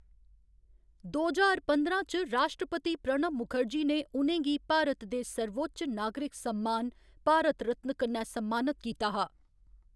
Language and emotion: Dogri, neutral